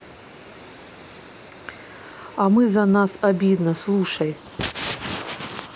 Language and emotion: Russian, neutral